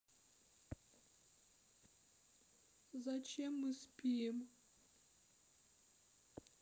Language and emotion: Russian, sad